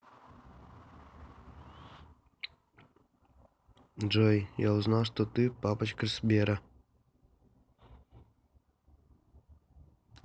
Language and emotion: Russian, neutral